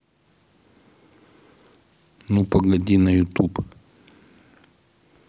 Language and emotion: Russian, neutral